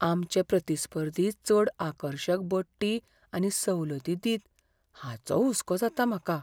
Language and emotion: Goan Konkani, fearful